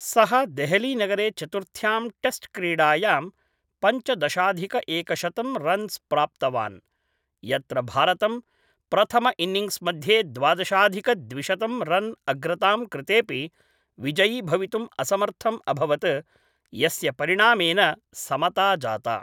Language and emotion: Sanskrit, neutral